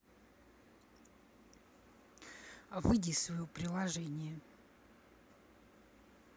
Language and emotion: Russian, angry